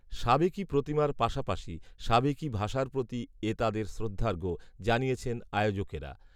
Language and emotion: Bengali, neutral